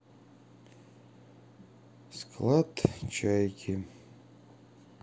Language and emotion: Russian, sad